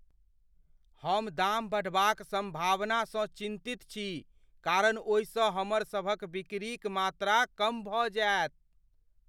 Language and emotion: Maithili, fearful